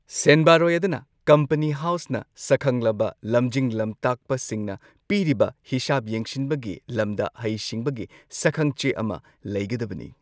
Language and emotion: Manipuri, neutral